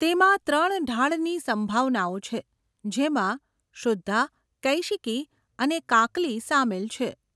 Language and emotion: Gujarati, neutral